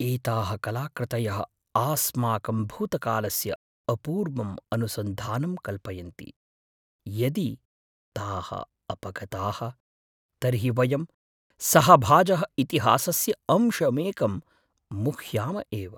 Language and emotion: Sanskrit, fearful